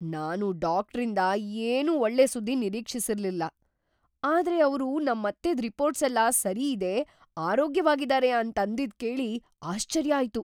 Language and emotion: Kannada, surprised